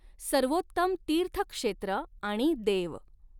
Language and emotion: Marathi, neutral